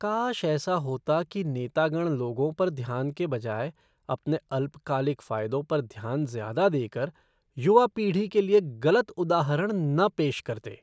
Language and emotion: Hindi, disgusted